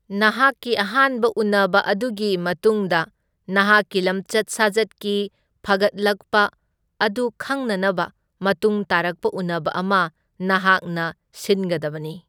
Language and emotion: Manipuri, neutral